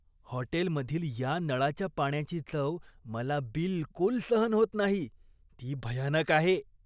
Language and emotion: Marathi, disgusted